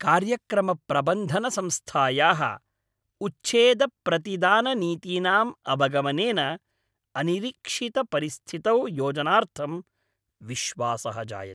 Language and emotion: Sanskrit, happy